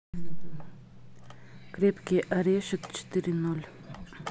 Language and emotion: Russian, neutral